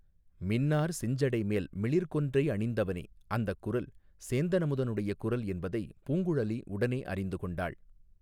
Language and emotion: Tamil, neutral